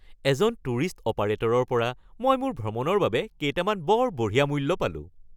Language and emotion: Assamese, happy